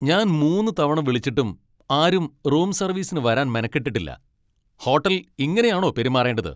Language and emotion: Malayalam, angry